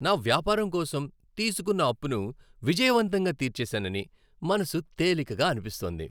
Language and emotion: Telugu, happy